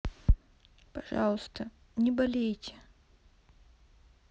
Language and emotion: Russian, sad